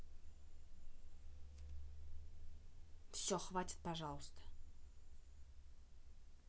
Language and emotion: Russian, angry